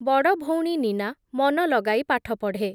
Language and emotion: Odia, neutral